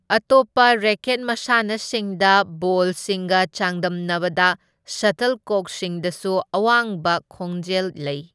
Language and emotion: Manipuri, neutral